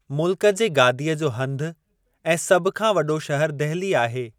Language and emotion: Sindhi, neutral